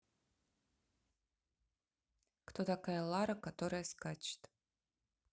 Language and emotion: Russian, neutral